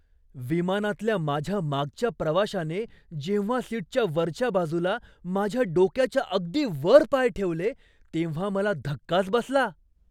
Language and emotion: Marathi, surprised